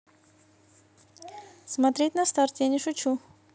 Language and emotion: Russian, neutral